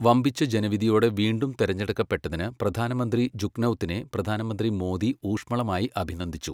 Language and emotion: Malayalam, neutral